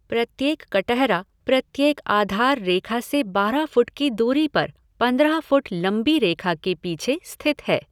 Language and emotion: Hindi, neutral